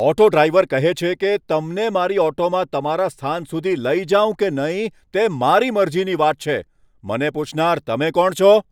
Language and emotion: Gujarati, angry